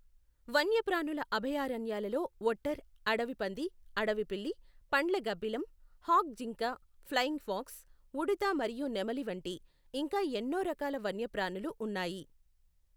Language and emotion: Telugu, neutral